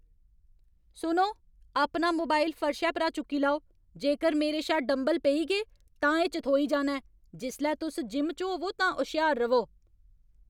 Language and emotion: Dogri, angry